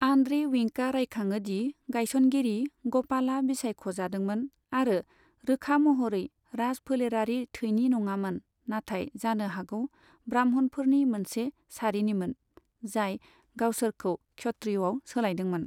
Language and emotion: Bodo, neutral